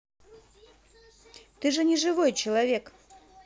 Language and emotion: Russian, positive